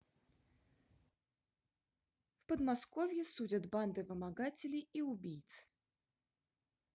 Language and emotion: Russian, neutral